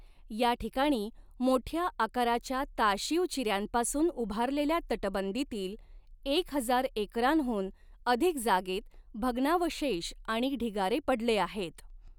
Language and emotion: Marathi, neutral